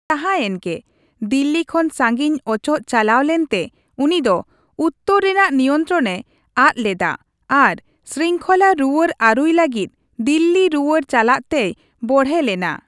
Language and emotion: Santali, neutral